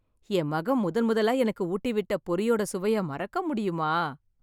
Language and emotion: Tamil, happy